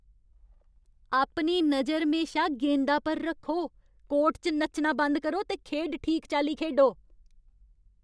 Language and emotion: Dogri, angry